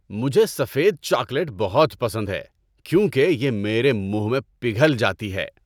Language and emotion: Urdu, happy